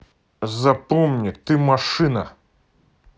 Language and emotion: Russian, angry